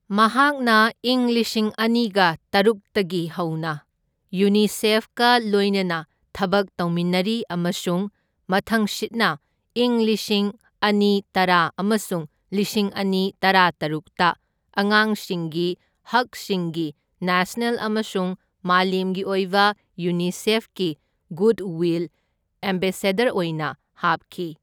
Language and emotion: Manipuri, neutral